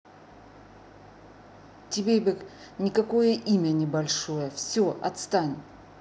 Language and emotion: Russian, angry